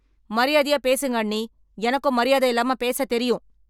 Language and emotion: Tamil, angry